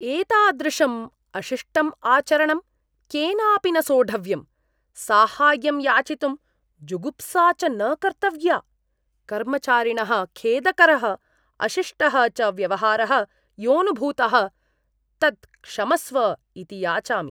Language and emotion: Sanskrit, disgusted